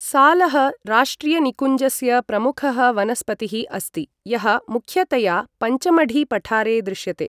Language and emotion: Sanskrit, neutral